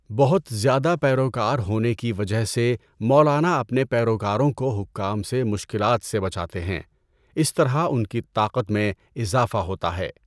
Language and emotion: Urdu, neutral